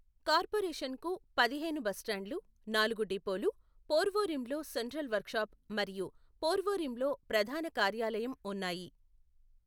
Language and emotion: Telugu, neutral